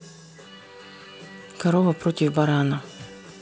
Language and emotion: Russian, neutral